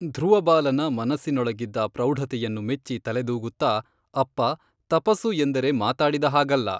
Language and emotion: Kannada, neutral